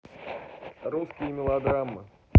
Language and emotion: Russian, neutral